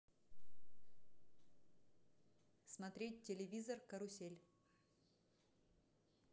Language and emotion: Russian, neutral